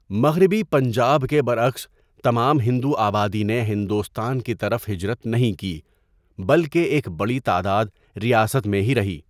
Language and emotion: Urdu, neutral